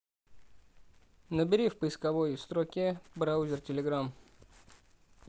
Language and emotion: Russian, neutral